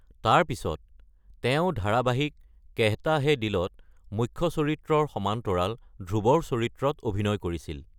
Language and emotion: Assamese, neutral